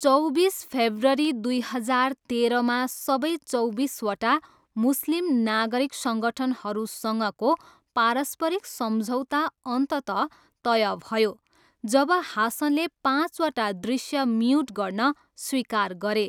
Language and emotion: Nepali, neutral